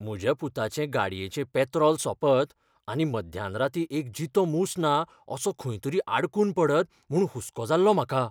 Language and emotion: Goan Konkani, fearful